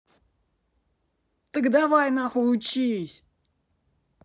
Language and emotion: Russian, angry